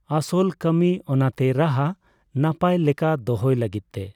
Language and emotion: Santali, neutral